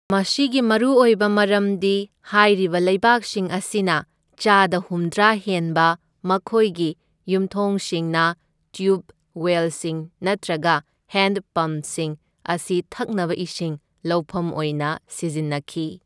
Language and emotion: Manipuri, neutral